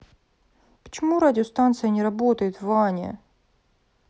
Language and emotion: Russian, sad